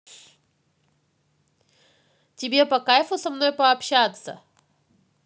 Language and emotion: Russian, neutral